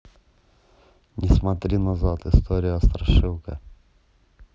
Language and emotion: Russian, neutral